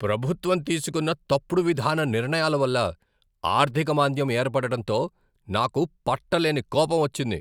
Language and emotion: Telugu, angry